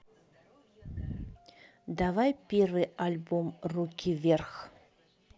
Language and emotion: Russian, neutral